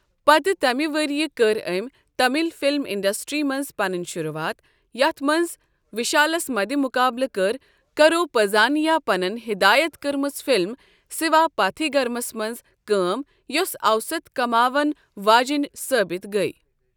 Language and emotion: Kashmiri, neutral